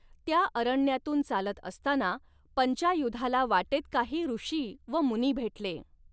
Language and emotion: Marathi, neutral